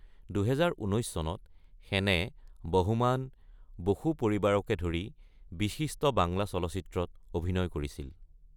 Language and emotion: Assamese, neutral